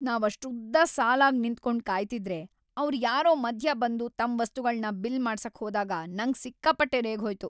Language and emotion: Kannada, angry